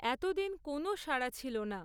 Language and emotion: Bengali, neutral